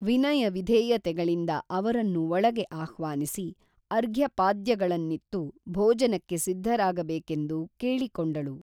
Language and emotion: Kannada, neutral